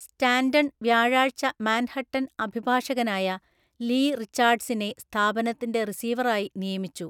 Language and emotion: Malayalam, neutral